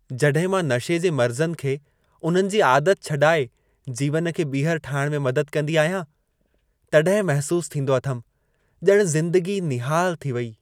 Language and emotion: Sindhi, happy